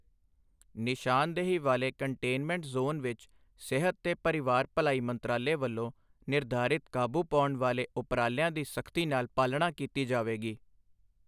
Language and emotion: Punjabi, neutral